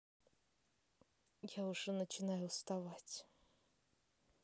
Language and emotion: Russian, neutral